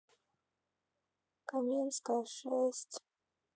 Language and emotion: Russian, sad